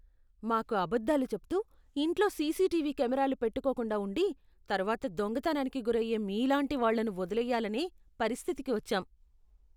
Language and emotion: Telugu, disgusted